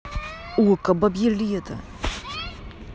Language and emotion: Russian, angry